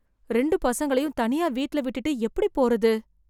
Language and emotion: Tamil, fearful